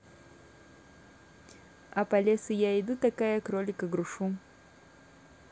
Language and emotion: Russian, neutral